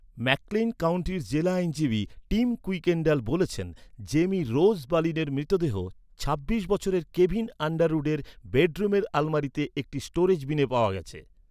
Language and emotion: Bengali, neutral